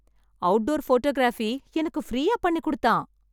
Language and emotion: Tamil, happy